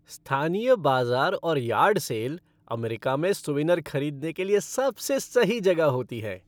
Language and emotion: Hindi, happy